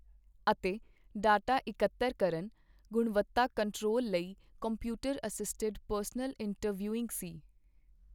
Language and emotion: Punjabi, neutral